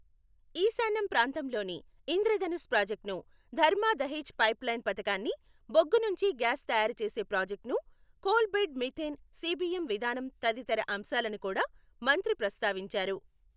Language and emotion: Telugu, neutral